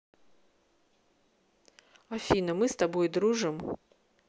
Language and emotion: Russian, neutral